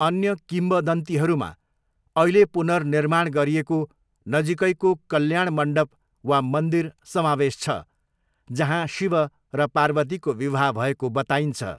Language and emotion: Nepali, neutral